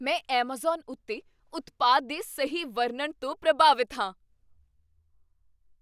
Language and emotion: Punjabi, surprised